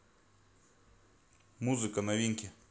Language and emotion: Russian, neutral